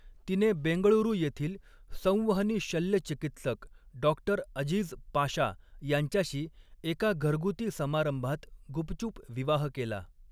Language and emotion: Marathi, neutral